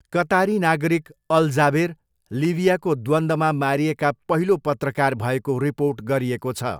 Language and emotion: Nepali, neutral